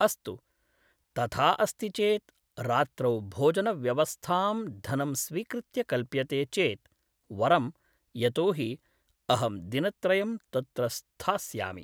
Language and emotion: Sanskrit, neutral